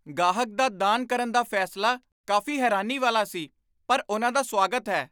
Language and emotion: Punjabi, surprised